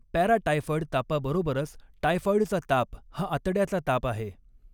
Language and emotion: Marathi, neutral